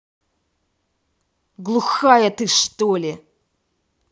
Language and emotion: Russian, angry